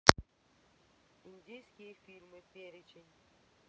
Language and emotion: Russian, neutral